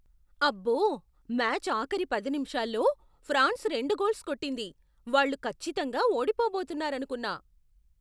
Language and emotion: Telugu, surprised